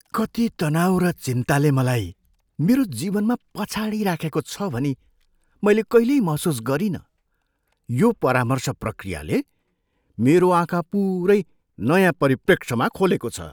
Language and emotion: Nepali, surprised